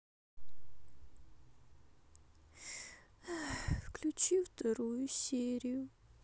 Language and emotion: Russian, sad